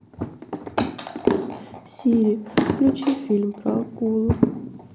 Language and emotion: Russian, sad